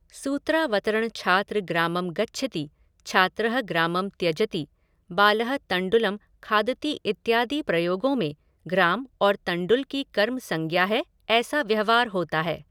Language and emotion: Hindi, neutral